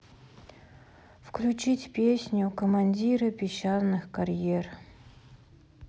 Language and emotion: Russian, sad